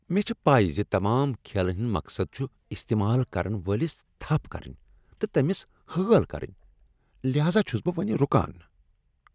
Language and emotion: Kashmiri, disgusted